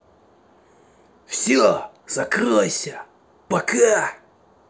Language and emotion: Russian, angry